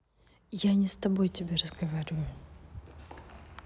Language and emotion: Russian, neutral